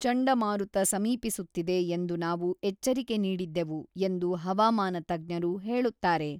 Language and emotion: Kannada, neutral